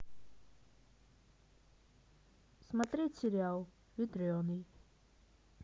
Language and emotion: Russian, neutral